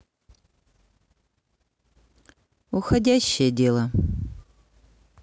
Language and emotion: Russian, neutral